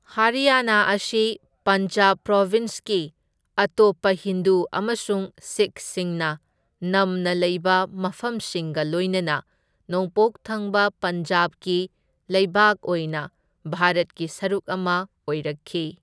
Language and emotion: Manipuri, neutral